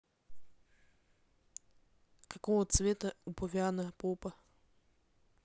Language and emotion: Russian, neutral